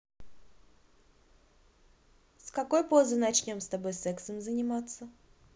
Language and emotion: Russian, neutral